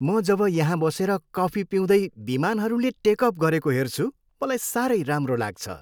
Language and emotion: Nepali, happy